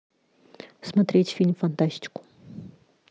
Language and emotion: Russian, neutral